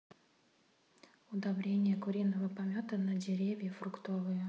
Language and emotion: Russian, neutral